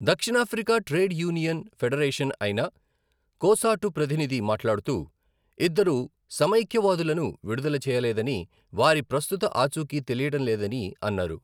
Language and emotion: Telugu, neutral